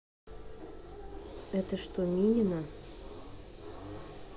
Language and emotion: Russian, neutral